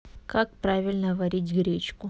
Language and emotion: Russian, neutral